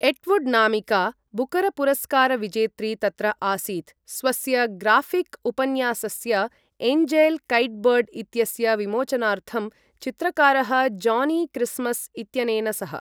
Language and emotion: Sanskrit, neutral